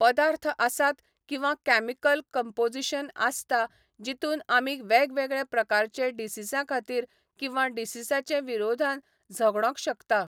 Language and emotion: Goan Konkani, neutral